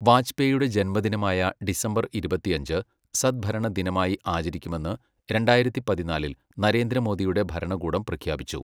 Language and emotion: Malayalam, neutral